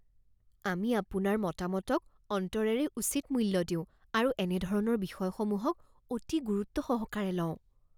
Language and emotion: Assamese, fearful